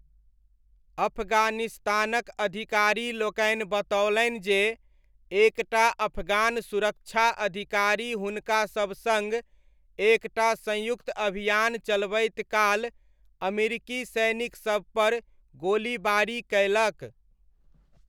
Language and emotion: Maithili, neutral